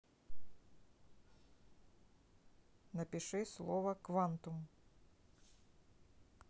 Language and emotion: Russian, neutral